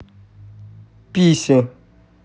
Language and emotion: Russian, neutral